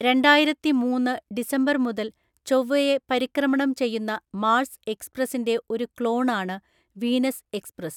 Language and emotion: Malayalam, neutral